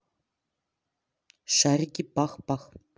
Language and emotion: Russian, neutral